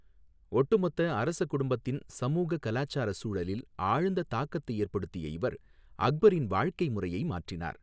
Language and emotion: Tamil, neutral